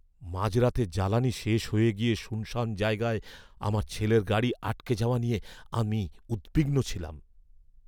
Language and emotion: Bengali, fearful